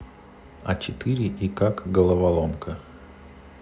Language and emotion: Russian, neutral